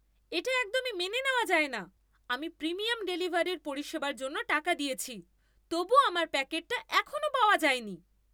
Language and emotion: Bengali, angry